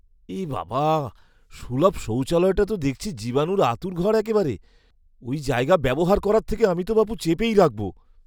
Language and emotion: Bengali, disgusted